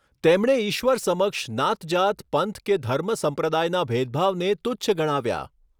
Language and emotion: Gujarati, neutral